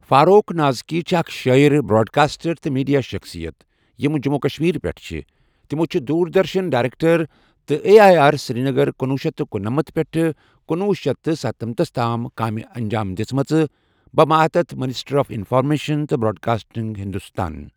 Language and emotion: Kashmiri, neutral